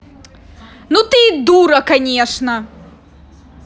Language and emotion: Russian, angry